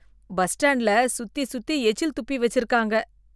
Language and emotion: Tamil, disgusted